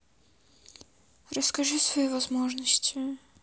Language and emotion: Russian, sad